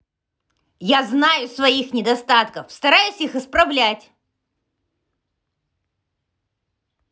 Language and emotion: Russian, angry